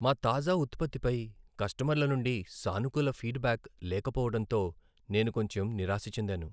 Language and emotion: Telugu, sad